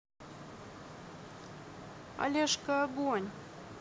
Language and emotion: Russian, neutral